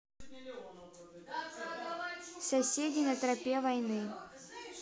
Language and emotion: Russian, neutral